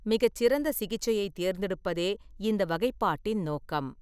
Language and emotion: Tamil, neutral